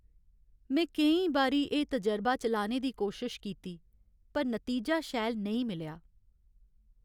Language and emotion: Dogri, sad